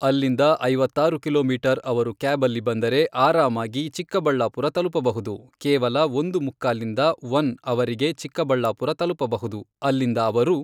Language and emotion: Kannada, neutral